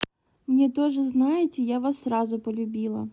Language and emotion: Russian, neutral